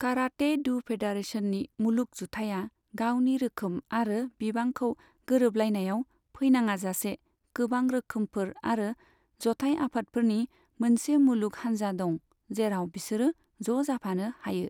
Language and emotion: Bodo, neutral